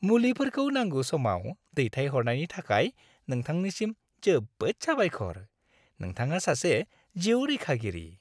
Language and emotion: Bodo, happy